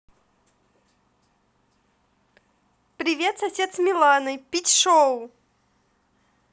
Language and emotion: Russian, positive